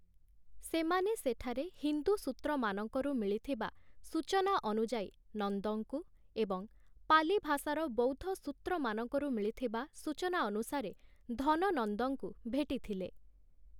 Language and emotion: Odia, neutral